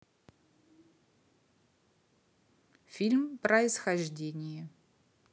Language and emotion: Russian, neutral